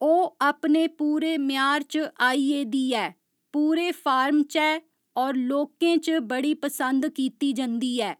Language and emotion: Dogri, neutral